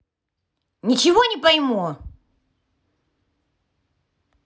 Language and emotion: Russian, angry